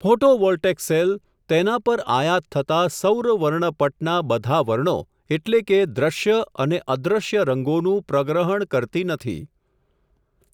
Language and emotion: Gujarati, neutral